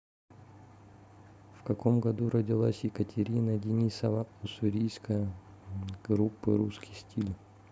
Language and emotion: Russian, neutral